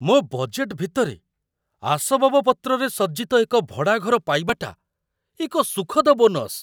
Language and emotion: Odia, surprised